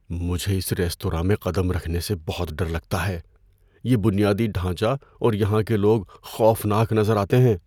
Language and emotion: Urdu, fearful